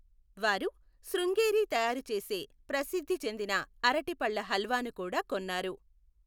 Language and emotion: Telugu, neutral